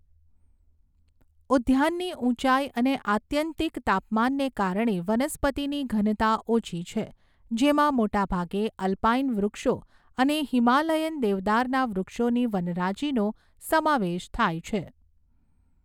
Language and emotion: Gujarati, neutral